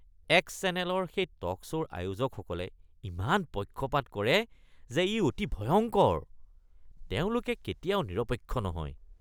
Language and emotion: Assamese, disgusted